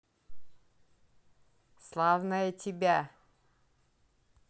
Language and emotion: Russian, positive